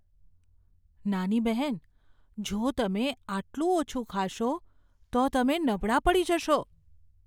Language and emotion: Gujarati, fearful